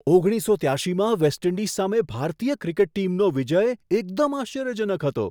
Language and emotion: Gujarati, surprised